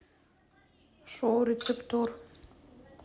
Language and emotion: Russian, neutral